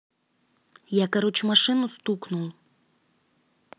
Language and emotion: Russian, neutral